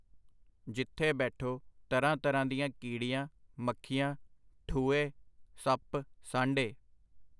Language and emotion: Punjabi, neutral